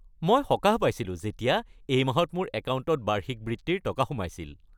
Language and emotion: Assamese, happy